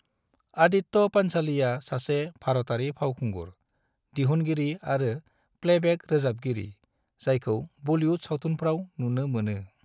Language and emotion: Bodo, neutral